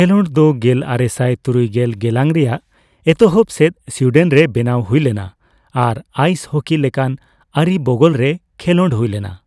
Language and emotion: Santali, neutral